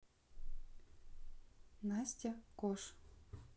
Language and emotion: Russian, neutral